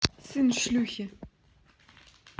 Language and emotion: Russian, neutral